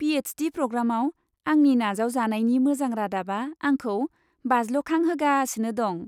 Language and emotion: Bodo, happy